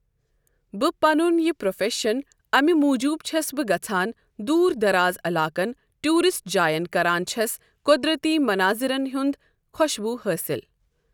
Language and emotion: Kashmiri, neutral